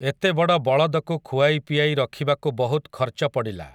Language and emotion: Odia, neutral